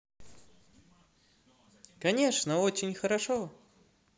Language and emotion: Russian, positive